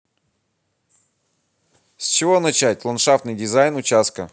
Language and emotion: Russian, positive